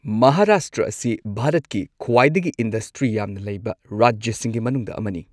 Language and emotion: Manipuri, neutral